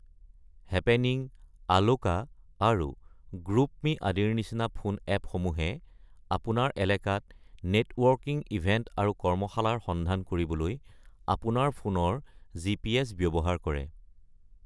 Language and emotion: Assamese, neutral